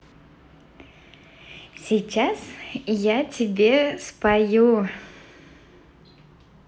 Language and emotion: Russian, positive